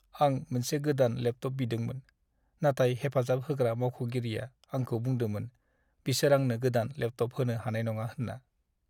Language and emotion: Bodo, sad